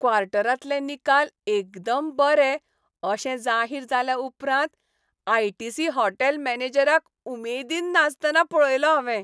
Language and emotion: Goan Konkani, happy